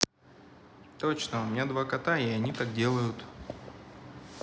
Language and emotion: Russian, neutral